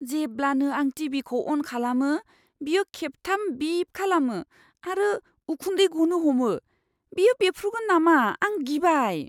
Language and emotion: Bodo, fearful